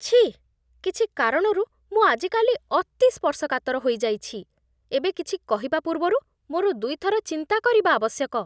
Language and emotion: Odia, disgusted